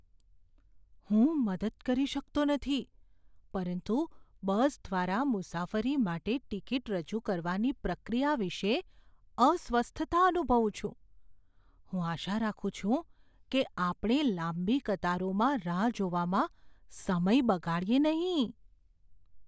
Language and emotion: Gujarati, fearful